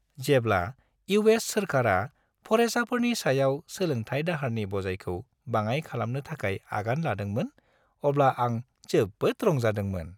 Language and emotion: Bodo, happy